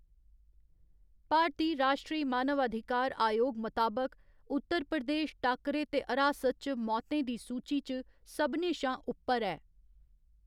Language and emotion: Dogri, neutral